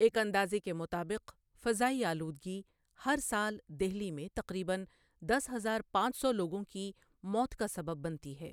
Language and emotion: Urdu, neutral